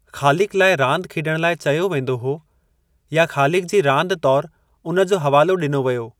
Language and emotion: Sindhi, neutral